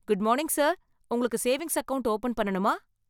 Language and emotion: Tamil, happy